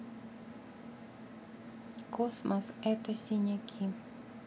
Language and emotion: Russian, neutral